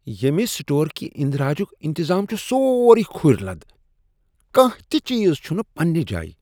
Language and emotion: Kashmiri, disgusted